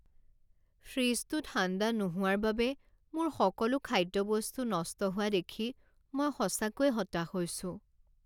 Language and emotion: Assamese, sad